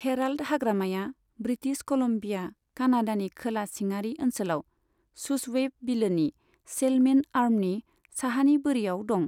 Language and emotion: Bodo, neutral